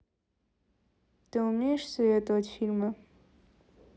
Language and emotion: Russian, neutral